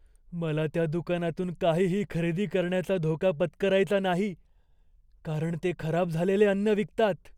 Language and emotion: Marathi, fearful